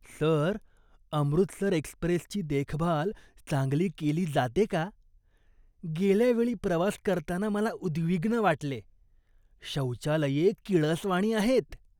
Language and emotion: Marathi, disgusted